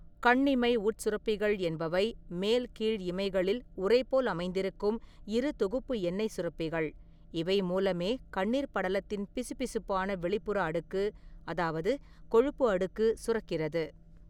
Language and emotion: Tamil, neutral